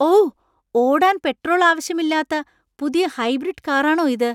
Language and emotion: Malayalam, surprised